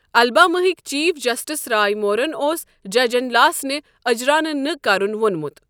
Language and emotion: Kashmiri, neutral